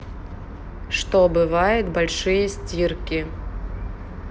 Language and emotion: Russian, neutral